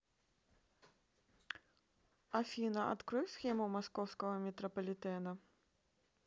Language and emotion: Russian, neutral